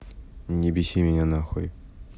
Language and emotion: Russian, neutral